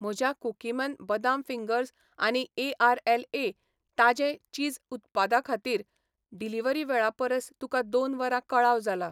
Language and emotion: Goan Konkani, neutral